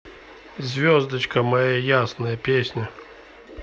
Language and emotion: Russian, neutral